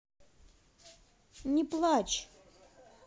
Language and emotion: Russian, neutral